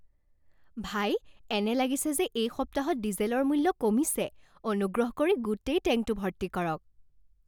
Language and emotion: Assamese, happy